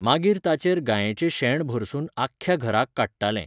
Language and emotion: Goan Konkani, neutral